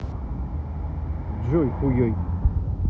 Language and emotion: Russian, neutral